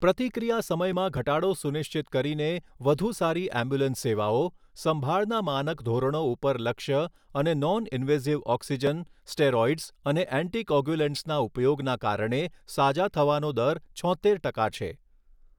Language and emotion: Gujarati, neutral